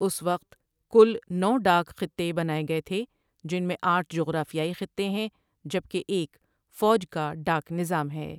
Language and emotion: Urdu, neutral